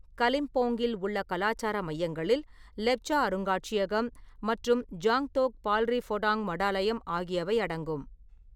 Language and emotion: Tamil, neutral